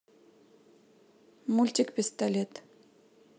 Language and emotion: Russian, neutral